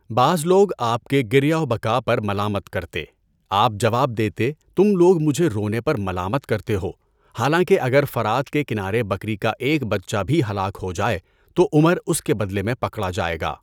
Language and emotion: Urdu, neutral